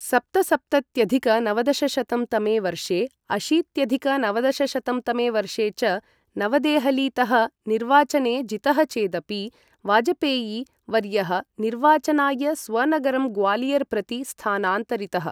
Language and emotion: Sanskrit, neutral